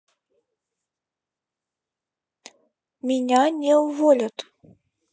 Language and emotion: Russian, neutral